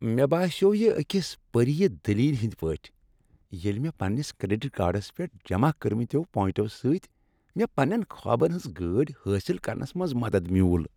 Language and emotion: Kashmiri, happy